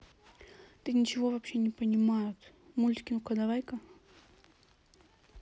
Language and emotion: Russian, neutral